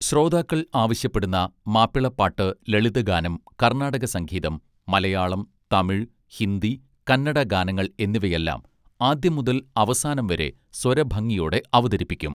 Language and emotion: Malayalam, neutral